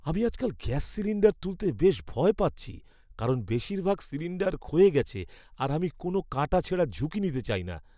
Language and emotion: Bengali, fearful